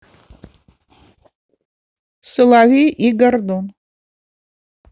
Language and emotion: Russian, neutral